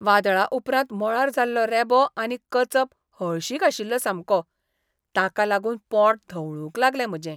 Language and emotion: Goan Konkani, disgusted